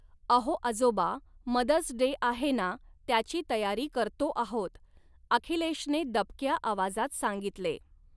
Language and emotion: Marathi, neutral